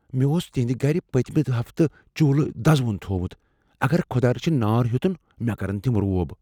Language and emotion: Kashmiri, fearful